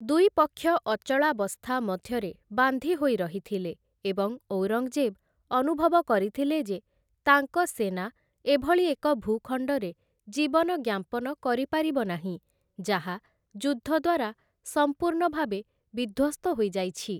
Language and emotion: Odia, neutral